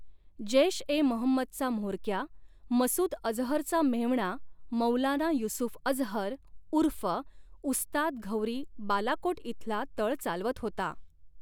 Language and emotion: Marathi, neutral